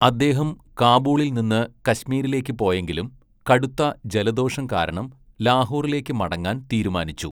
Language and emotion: Malayalam, neutral